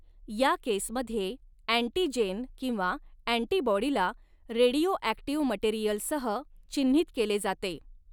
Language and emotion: Marathi, neutral